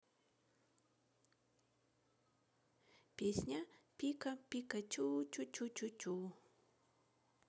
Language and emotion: Russian, neutral